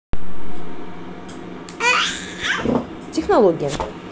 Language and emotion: Russian, neutral